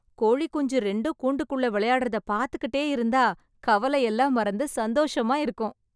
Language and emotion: Tamil, happy